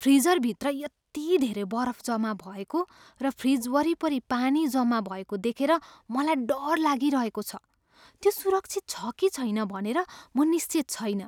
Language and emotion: Nepali, fearful